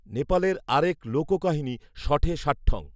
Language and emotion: Bengali, neutral